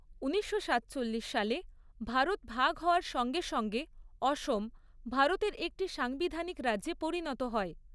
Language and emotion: Bengali, neutral